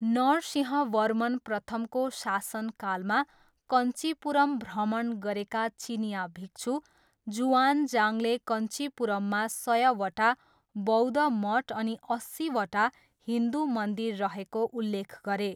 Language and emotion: Nepali, neutral